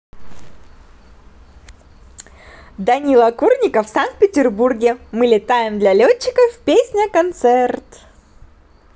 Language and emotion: Russian, positive